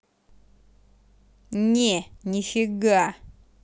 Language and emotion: Russian, angry